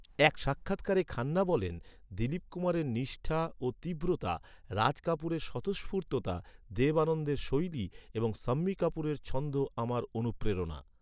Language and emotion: Bengali, neutral